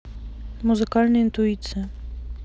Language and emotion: Russian, neutral